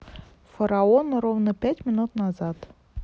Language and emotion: Russian, neutral